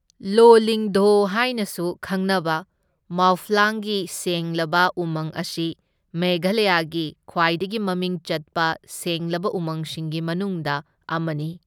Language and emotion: Manipuri, neutral